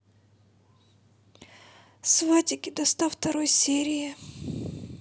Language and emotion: Russian, sad